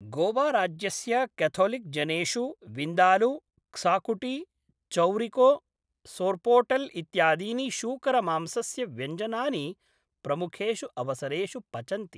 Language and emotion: Sanskrit, neutral